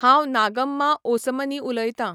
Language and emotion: Goan Konkani, neutral